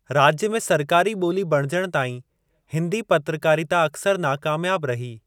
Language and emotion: Sindhi, neutral